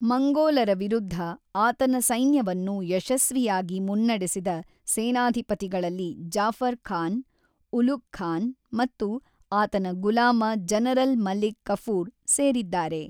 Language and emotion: Kannada, neutral